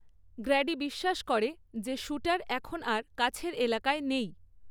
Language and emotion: Bengali, neutral